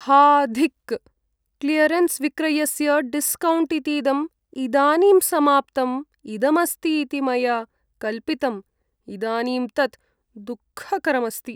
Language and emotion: Sanskrit, sad